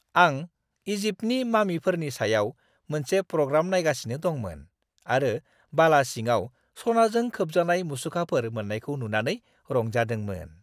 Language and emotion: Bodo, happy